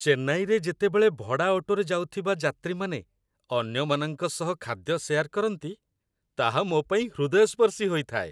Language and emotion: Odia, happy